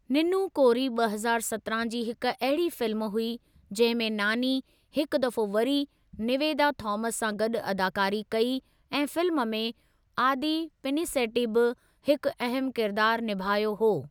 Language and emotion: Sindhi, neutral